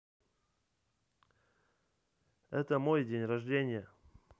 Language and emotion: Russian, neutral